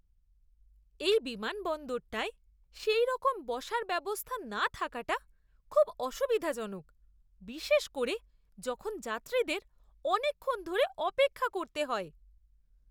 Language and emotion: Bengali, disgusted